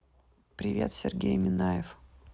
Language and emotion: Russian, neutral